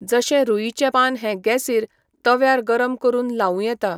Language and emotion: Goan Konkani, neutral